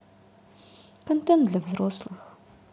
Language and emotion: Russian, sad